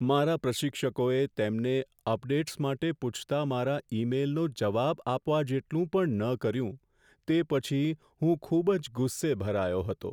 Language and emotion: Gujarati, sad